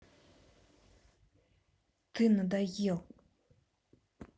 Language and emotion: Russian, angry